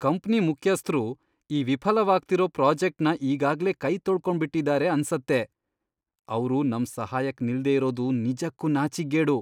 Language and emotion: Kannada, disgusted